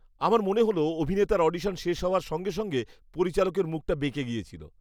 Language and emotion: Bengali, disgusted